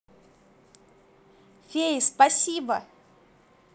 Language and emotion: Russian, positive